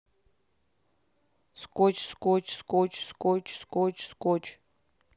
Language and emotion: Russian, neutral